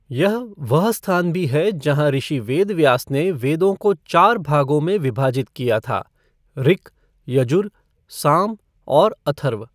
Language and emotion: Hindi, neutral